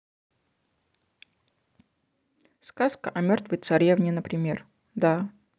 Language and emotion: Russian, neutral